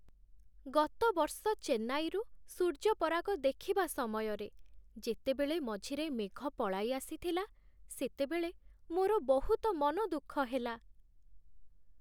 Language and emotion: Odia, sad